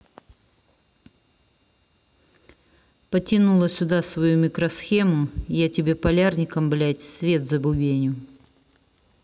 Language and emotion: Russian, angry